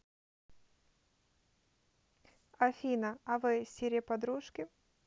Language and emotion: Russian, neutral